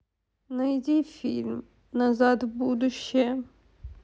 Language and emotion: Russian, sad